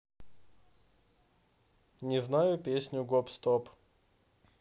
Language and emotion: Russian, neutral